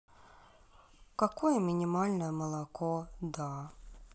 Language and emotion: Russian, sad